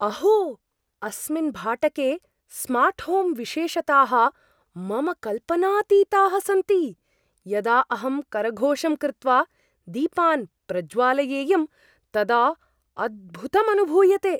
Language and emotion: Sanskrit, surprised